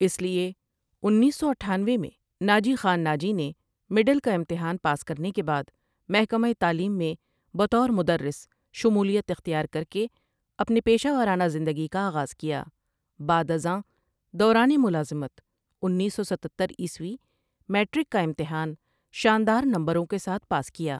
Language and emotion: Urdu, neutral